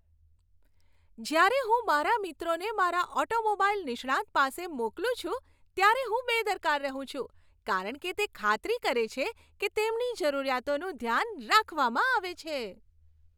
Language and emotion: Gujarati, happy